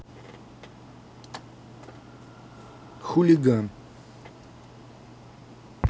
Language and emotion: Russian, neutral